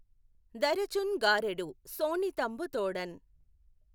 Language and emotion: Telugu, neutral